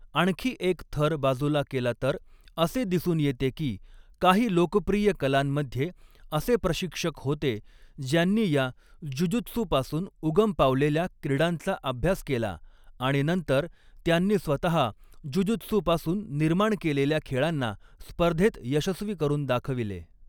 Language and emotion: Marathi, neutral